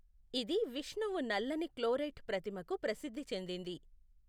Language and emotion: Telugu, neutral